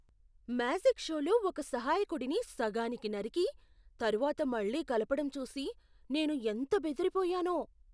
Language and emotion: Telugu, surprised